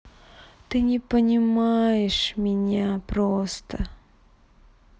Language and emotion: Russian, sad